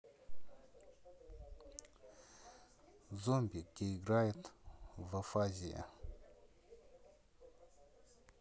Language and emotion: Russian, neutral